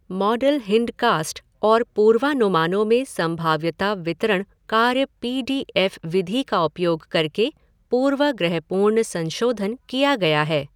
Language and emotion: Hindi, neutral